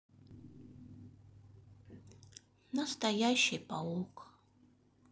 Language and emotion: Russian, sad